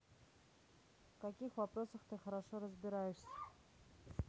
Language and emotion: Russian, neutral